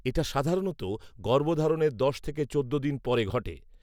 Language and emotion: Bengali, neutral